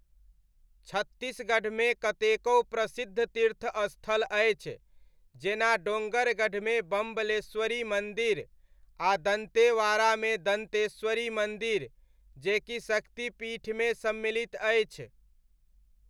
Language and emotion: Maithili, neutral